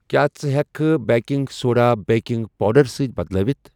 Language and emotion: Kashmiri, neutral